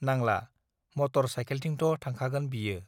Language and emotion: Bodo, neutral